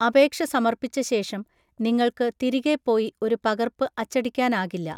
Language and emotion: Malayalam, neutral